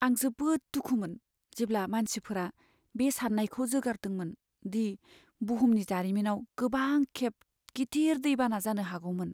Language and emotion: Bodo, sad